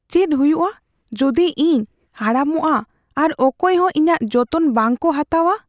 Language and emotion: Santali, fearful